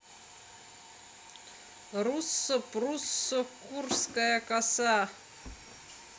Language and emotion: Russian, positive